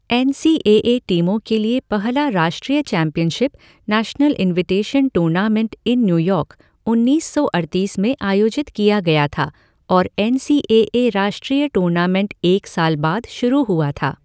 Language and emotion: Hindi, neutral